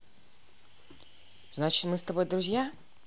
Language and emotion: Russian, neutral